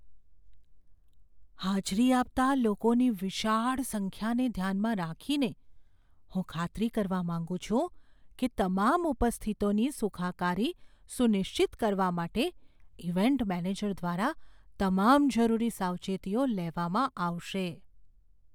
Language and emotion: Gujarati, fearful